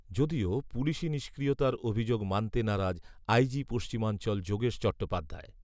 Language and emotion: Bengali, neutral